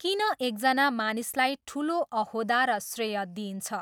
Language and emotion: Nepali, neutral